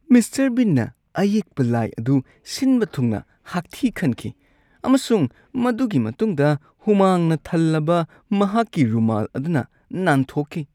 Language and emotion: Manipuri, disgusted